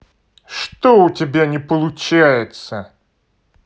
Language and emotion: Russian, angry